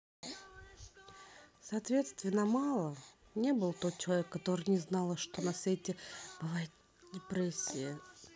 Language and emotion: Russian, neutral